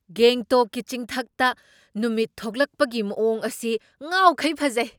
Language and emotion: Manipuri, surprised